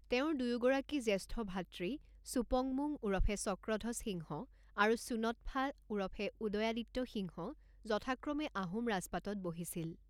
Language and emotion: Assamese, neutral